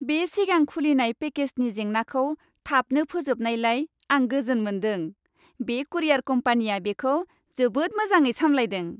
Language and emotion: Bodo, happy